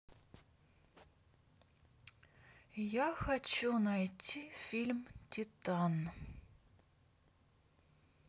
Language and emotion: Russian, neutral